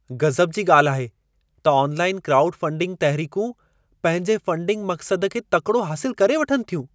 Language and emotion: Sindhi, surprised